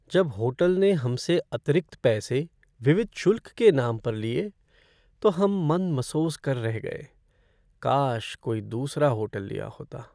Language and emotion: Hindi, sad